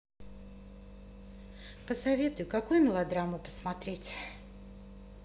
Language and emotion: Russian, neutral